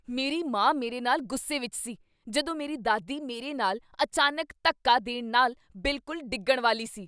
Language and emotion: Punjabi, angry